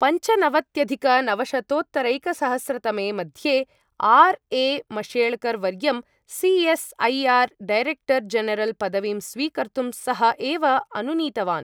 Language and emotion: Sanskrit, neutral